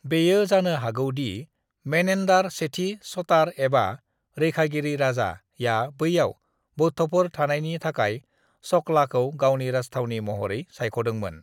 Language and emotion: Bodo, neutral